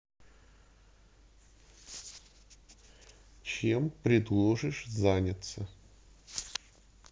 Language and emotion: Russian, neutral